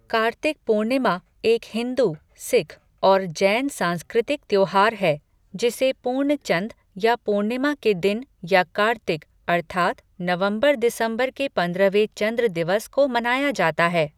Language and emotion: Hindi, neutral